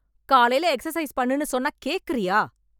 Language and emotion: Tamil, angry